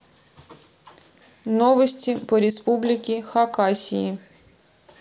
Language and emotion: Russian, neutral